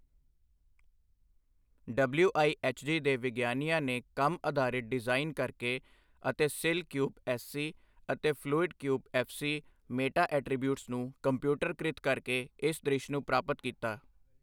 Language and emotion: Punjabi, neutral